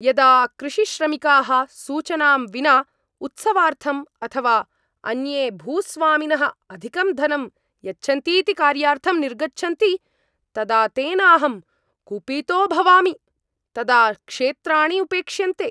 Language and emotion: Sanskrit, angry